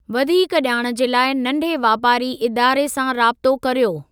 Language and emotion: Sindhi, neutral